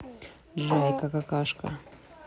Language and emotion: Russian, neutral